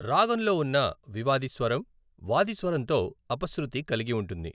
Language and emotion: Telugu, neutral